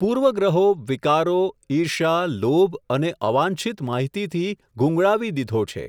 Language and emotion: Gujarati, neutral